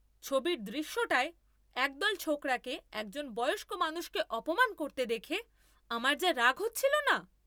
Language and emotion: Bengali, angry